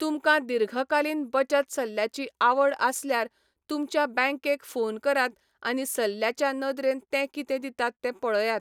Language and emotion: Goan Konkani, neutral